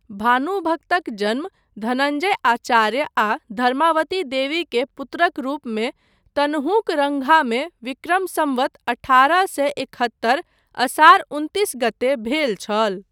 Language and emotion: Maithili, neutral